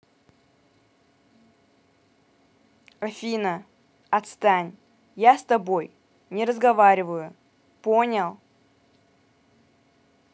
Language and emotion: Russian, angry